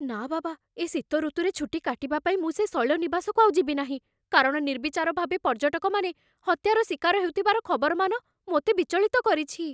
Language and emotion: Odia, fearful